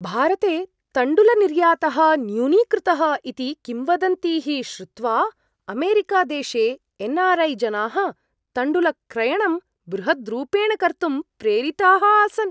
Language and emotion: Sanskrit, surprised